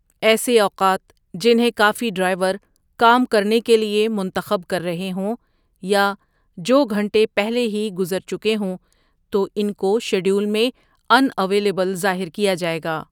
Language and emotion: Urdu, neutral